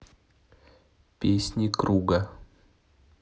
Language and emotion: Russian, neutral